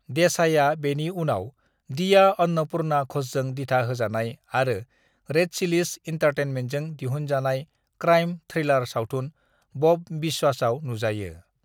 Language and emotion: Bodo, neutral